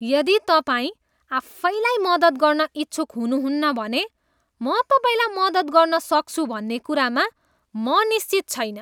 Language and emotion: Nepali, disgusted